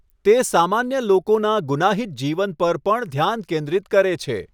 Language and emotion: Gujarati, neutral